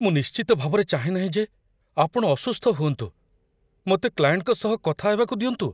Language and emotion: Odia, fearful